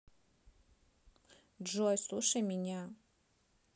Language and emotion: Russian, neutral